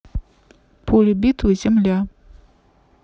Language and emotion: Russian, neutral